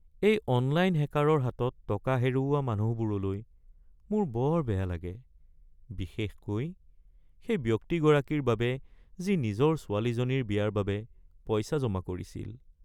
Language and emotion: Assamese, sad